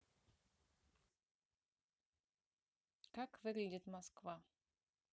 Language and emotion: Russian, neutral